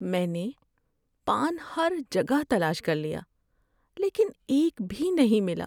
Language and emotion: Urdu, sad